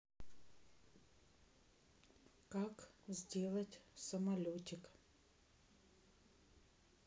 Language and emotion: Russian, neutral